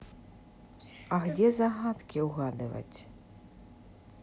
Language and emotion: Russian, neutral